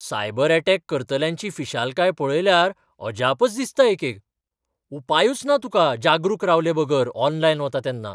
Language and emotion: Goan Konkani, surprised